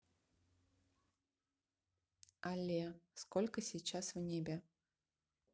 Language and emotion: Russian, neutral